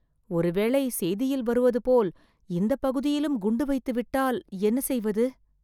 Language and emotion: Tamil, fearful